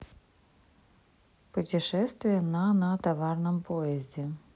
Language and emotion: Russian, neutral